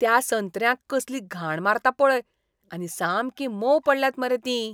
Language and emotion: Goan Konkani, disgusted